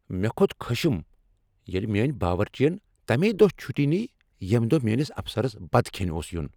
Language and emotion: Kashmiri, angry